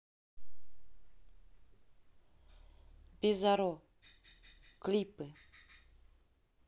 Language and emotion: Russian, neutral